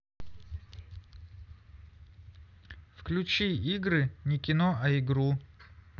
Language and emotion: Russian, neutral